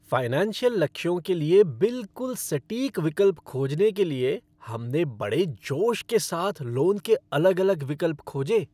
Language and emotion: Hindi, happy